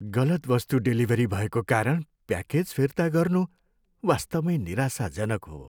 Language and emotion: Nepali, sad